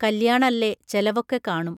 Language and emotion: Malayalam, neutral